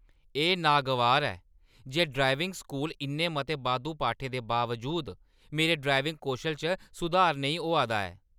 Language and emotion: Dogri, angry